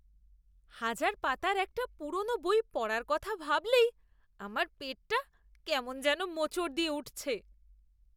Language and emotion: Bengali, disgusted